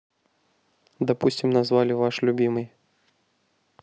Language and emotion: Russian, neutral